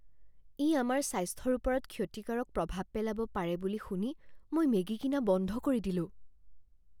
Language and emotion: Assamese, fearful